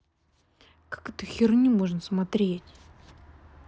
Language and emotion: Russian, angry